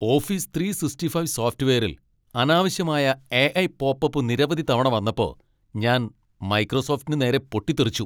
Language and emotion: Malayalam, angry